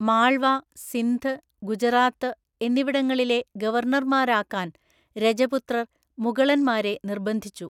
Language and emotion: Malayalam, neutral